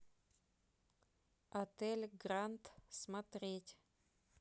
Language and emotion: Russian, neutral